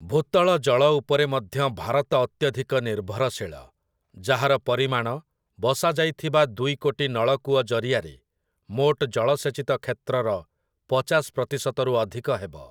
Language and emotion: Odia, neutral